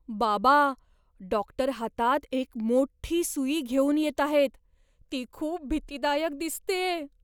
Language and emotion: Marathi, fearful